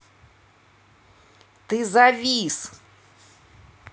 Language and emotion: Russian, angry